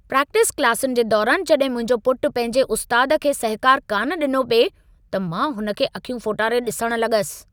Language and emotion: Sindhi, angry